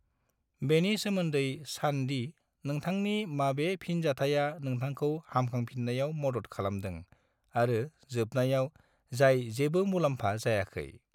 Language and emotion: Bodo, neutral